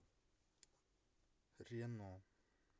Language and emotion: Russian, neutral